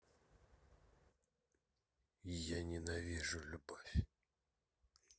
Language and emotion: Russian, sad